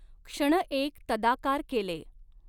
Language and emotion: Marathi, neutral